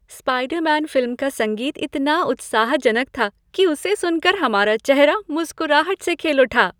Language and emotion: Hindi, happy